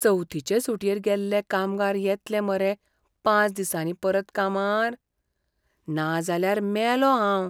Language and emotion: Goan Konkani, fearful